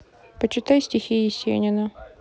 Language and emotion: Russian, neutral